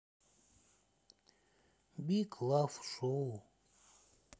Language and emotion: Russian, sad